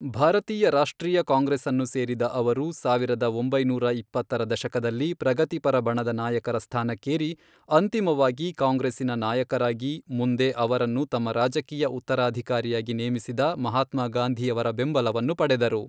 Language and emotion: Kannada, neutral